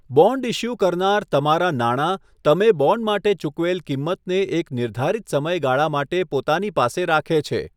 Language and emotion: Gujarati, neutral